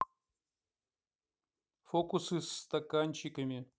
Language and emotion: Russian, neutral